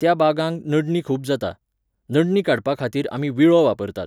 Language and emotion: Goan Konkani, neutral